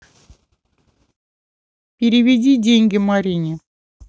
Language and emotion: Russian, neutral